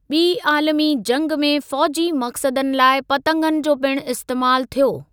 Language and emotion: Sindhi, neutral